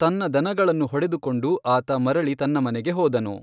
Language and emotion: Kannada, neutral